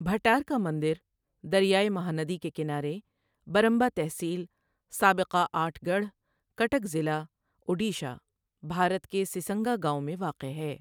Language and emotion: Urdu, neutral